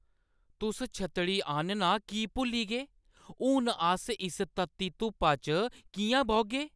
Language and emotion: Dogri, angry